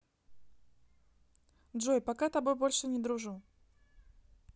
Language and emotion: Russian, neutral